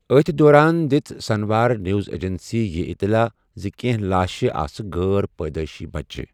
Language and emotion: Kashmiri, neutral